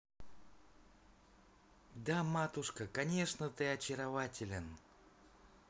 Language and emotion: Russian, positive